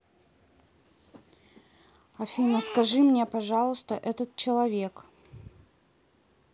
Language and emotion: Russian, neutral